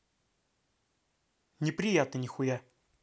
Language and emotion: Russian, angry